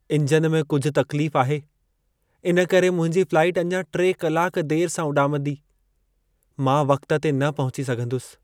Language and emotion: Sindhi, sad